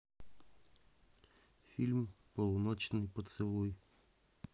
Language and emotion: Russian, neutral